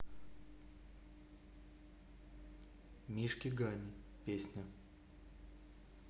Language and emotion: Russian, neutral